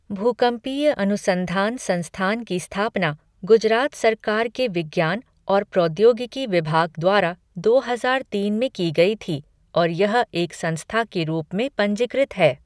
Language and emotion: Hindi, neutral